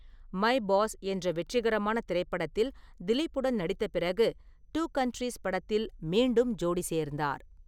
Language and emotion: Tamil, neutral